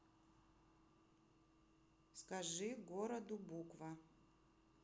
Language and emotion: Russian, neutral